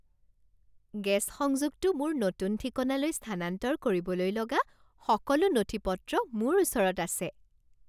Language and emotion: Assamese, happy